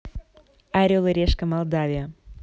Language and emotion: Russian, positive